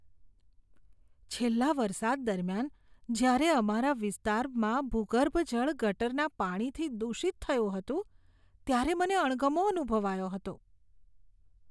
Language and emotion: Gujarati, disgusted